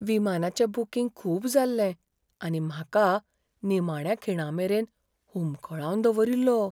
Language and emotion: Goan Konkani, fearful